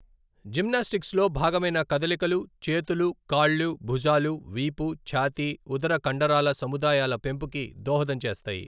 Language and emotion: Telugu, neutral